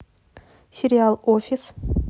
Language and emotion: Russian, neutral